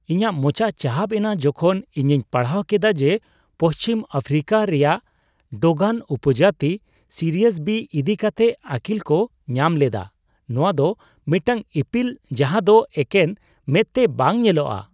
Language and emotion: Santali, surprised